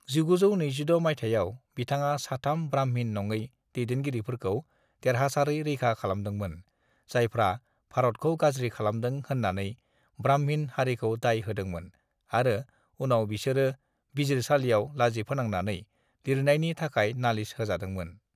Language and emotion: Bodo, neutral